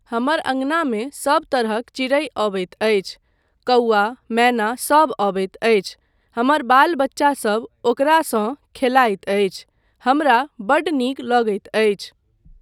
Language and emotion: Maithili, neutral